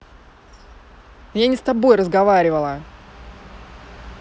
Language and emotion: Russian, angry